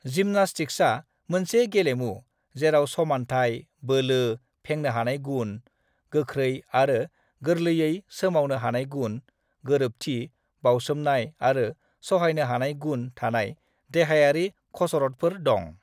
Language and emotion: Bodo, neutral